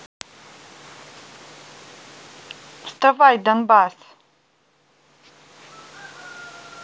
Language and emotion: Russian, angry